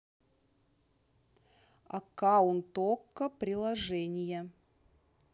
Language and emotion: Russian, neutral